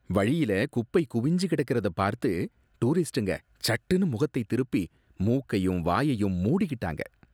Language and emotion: Tamil, disgusted